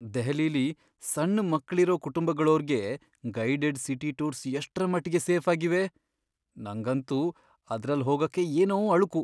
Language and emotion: Kannada, fearful